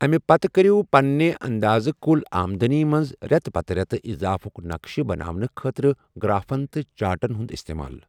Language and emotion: Kashmiri, neutral